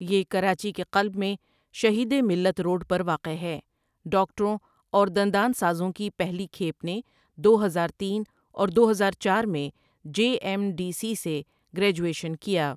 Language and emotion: Urdu, neutral